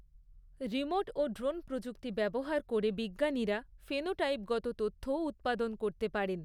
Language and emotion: Bengali, neutral